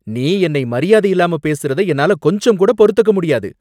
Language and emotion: Tamil, angry